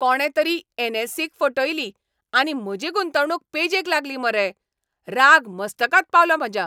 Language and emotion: Goan Konkani, angry